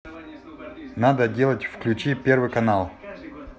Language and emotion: Russian, neutral